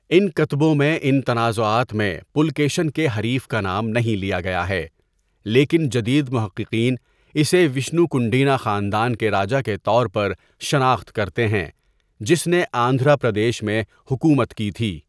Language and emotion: Urdu, neutral